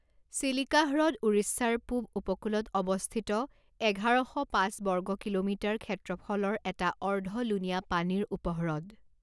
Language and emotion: Assamese, neutral